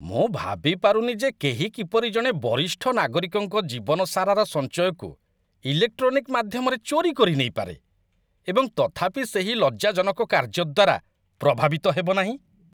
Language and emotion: Odia, disgusted